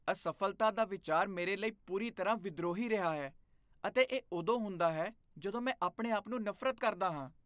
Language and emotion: Punjabi, disgusted